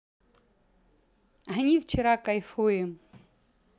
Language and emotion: Russian, positive